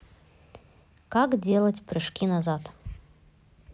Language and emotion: Russian, neutral